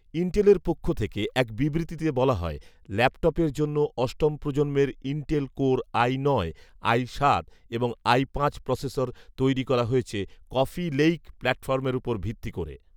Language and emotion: Bengali, neutral